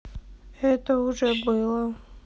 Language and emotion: Russian, sad